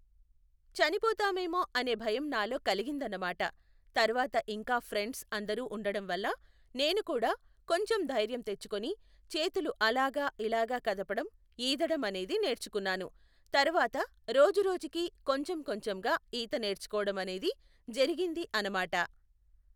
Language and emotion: Telugu, neutral